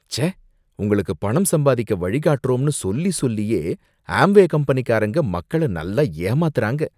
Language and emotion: Tamil, disgusted